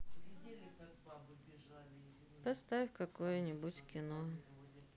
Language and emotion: Russian, sad